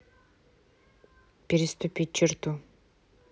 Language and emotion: Russian, neutral